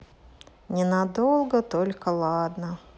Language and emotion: Russian, sad